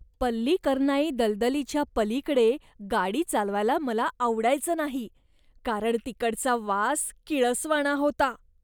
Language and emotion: Marathi, disgusted